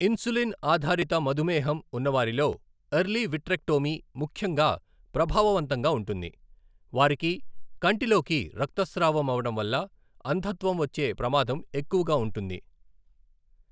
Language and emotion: Telugu, neutral